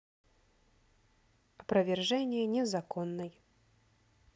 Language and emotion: Russian, neutral